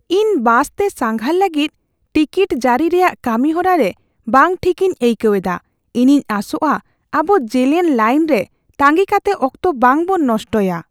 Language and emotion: Santali, fearful